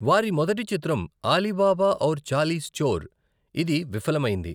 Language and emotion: Telugu, neutral